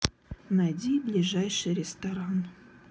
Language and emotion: Russian, sad